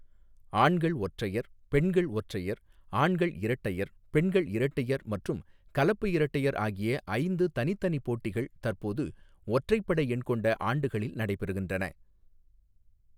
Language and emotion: Tamil, neutral